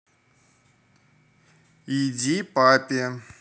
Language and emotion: Russian, neutral